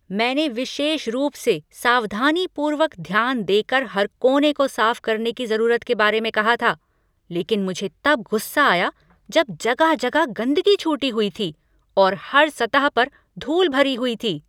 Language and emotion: Hindi, angry